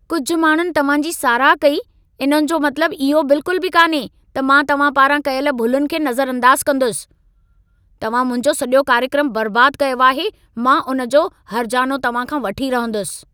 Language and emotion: Sindhi, angry